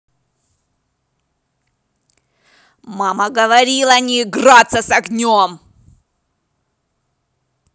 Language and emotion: Russian, angry